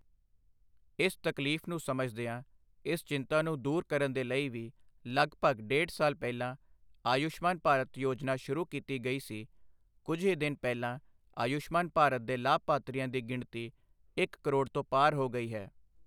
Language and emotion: Punjabi, neutral